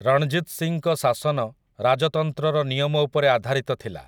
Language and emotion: Odia, neutral